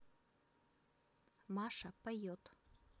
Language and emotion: Russian, neutral